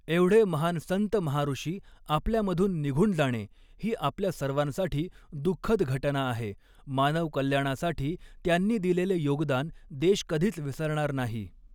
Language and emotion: Marathi, neutral